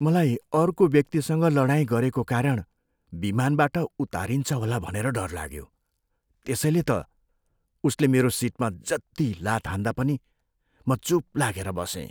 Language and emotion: Nepali, fearful